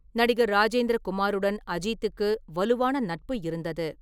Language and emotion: Tamil, neutral